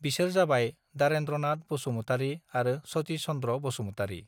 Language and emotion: Bodo, neutral